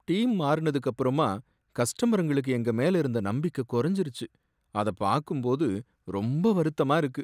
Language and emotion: Tamil, sad